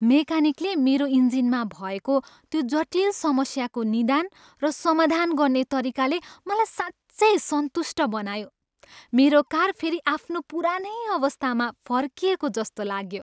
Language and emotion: Nepali, happy